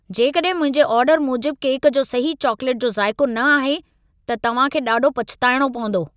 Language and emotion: Sindhi, angry